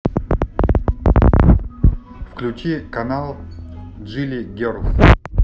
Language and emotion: Russian, neutral